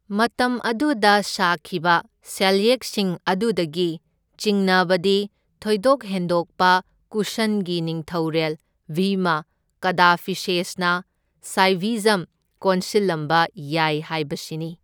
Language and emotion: Manipuri, neutral